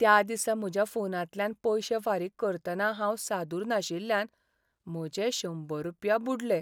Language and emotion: Goan Konkani, sad